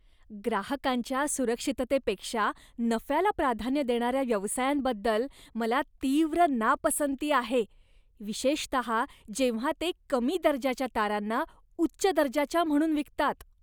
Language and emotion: Marathi, disgusted